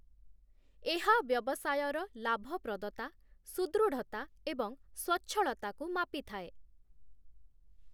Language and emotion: Odia, neutral